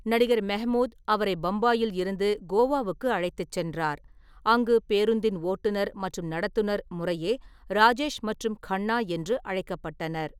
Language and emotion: Tamil, neutral